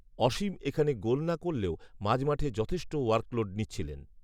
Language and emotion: Bengali, neutral